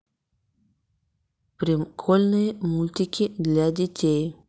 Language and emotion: Russian, neutral